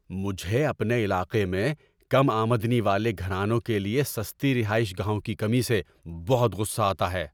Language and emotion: Urdu, angry